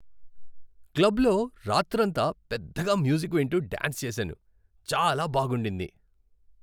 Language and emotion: Telugu, happy